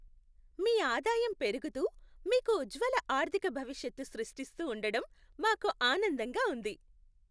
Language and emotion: Telugu, happy